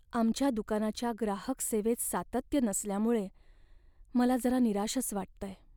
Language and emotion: Marathi, sad